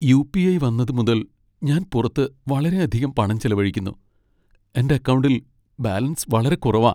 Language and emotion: Malayalam, sad